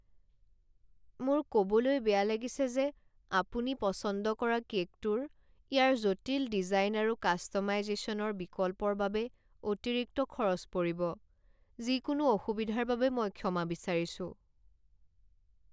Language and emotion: Assamese, sad